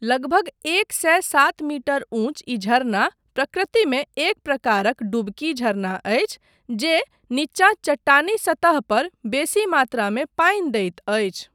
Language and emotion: Maithili, neutral